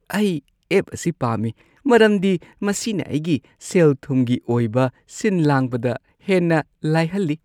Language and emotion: Manipuri, happy